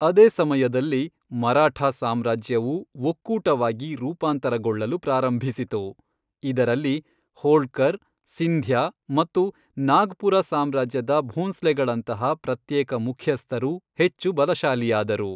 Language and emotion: Kannada, neutral